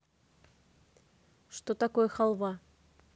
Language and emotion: Russian, neutral